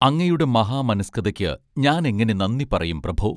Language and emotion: Malayalam, neutral